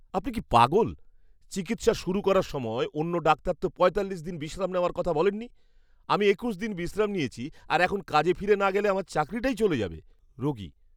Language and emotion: Bengali, angry